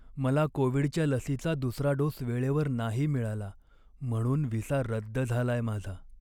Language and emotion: Marathi, sad